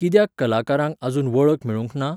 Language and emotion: Goan Konkani, neutral